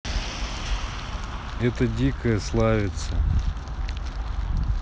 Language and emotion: Russian, neutral